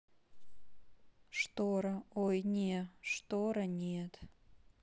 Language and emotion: Russian, neutral